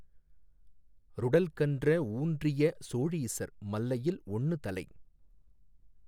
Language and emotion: Tamil, neutral